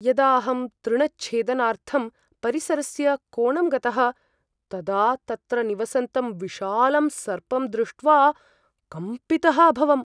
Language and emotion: Sanskrit, fearful